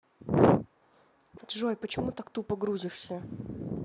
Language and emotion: Russian, angry